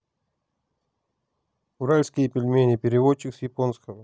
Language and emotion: Russian, neutral